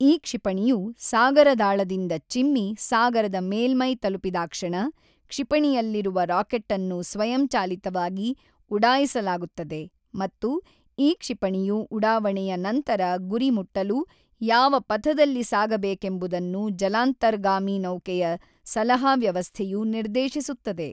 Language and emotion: Kannada, neutral